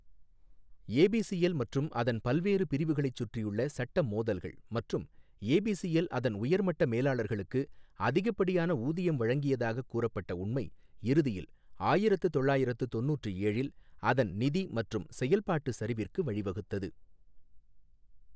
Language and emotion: Tamil, neutral